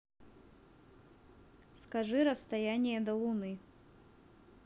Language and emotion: Russian, neutral